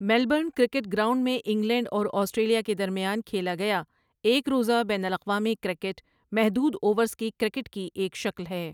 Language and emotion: Urdu, neutral